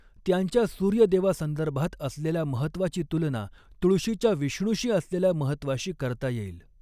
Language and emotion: Marathi, neutral